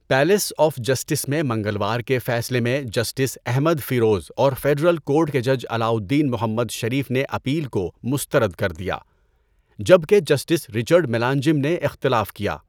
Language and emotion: Urdu, neutral